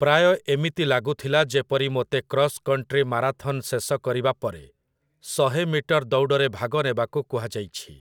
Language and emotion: Odia, neutral